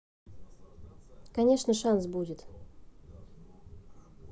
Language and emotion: Russian, neutral